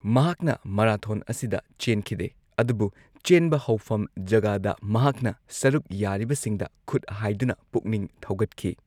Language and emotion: Manipuri, neutral